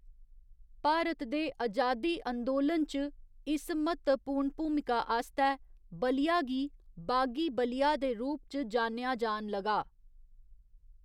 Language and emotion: Dogri, neutral